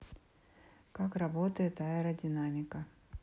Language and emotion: Russian, neutral